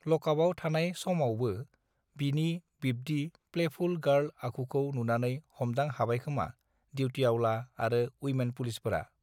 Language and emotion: Bodo, neutral